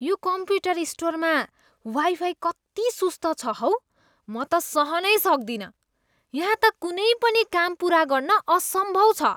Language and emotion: Nepali, disgusted